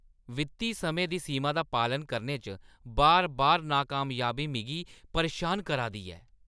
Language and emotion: Dogri, angry